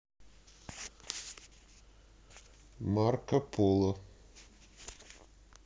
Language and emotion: Russian, neutral